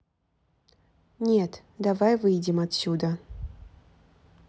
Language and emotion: Russian, neutral